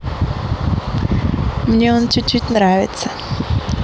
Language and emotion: Russian, positive